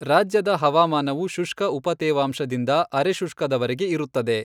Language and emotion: Kannada, neutral